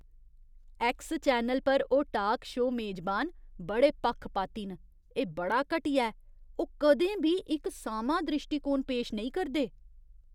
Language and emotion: Dogri, disgusted